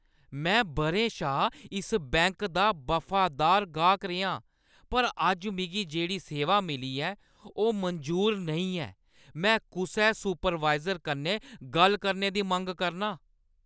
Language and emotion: Dogri, angry